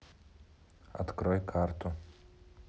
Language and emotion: Russian, neutral